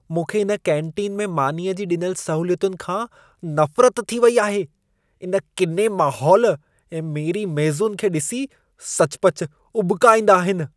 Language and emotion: Sindhi, disgusted